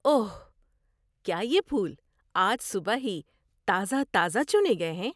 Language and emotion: Urdu, surprised